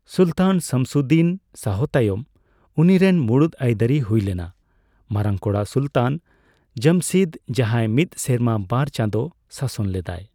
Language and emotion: Santali, neutral